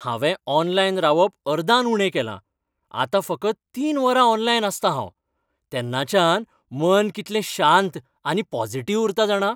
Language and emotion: Goan Konkani, happy